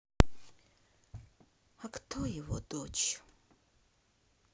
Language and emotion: Russian, sad